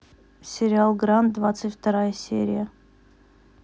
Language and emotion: Russian, neutral